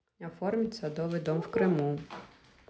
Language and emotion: Russian, neutral